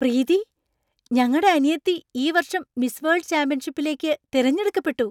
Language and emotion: Malayalam, surprised